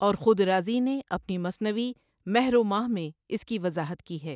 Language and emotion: Urdu, neutral